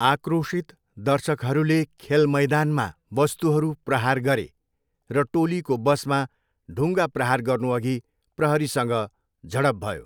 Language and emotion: Nepali, neutral